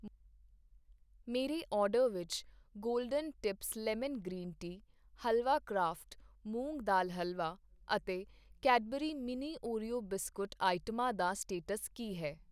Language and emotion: Punjabi, neutral